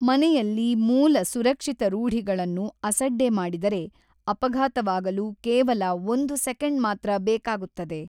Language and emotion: Kannada, neutral